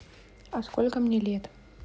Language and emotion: Russian, neutral